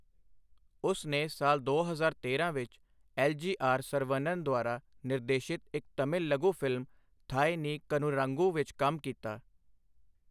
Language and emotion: Punjabi, neutral